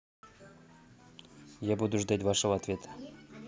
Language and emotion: Russian, neutral